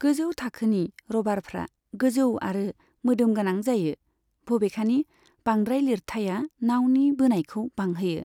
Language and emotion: Bodo, neutral